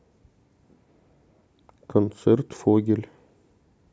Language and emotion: Russian, neutral